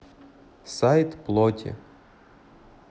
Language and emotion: Russian, neutral